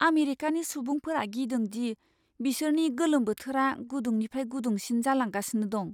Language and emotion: Bodo, fearful